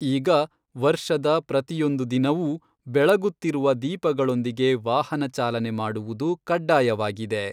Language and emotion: Kannada, neutral